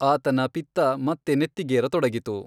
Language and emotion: Kannada, neutral